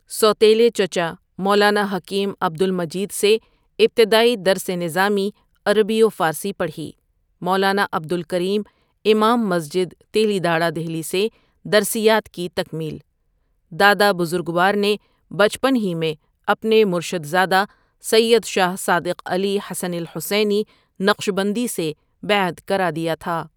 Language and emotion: Urdu, neutral